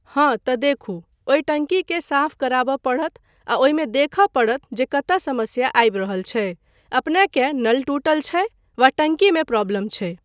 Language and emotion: Maithili, neutral